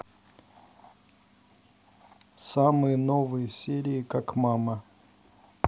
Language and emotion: Russian, neutral